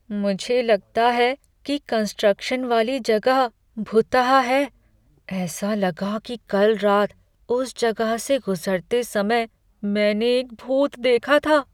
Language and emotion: Hindi, fearful